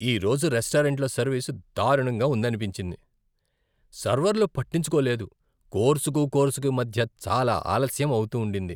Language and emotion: Telugu, disgusted